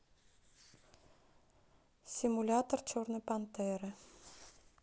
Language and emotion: Russian, neutral